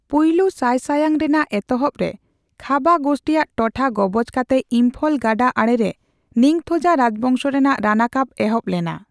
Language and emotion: Santali, neutral